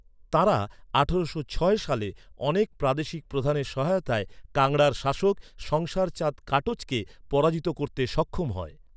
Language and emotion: Bengali, neutral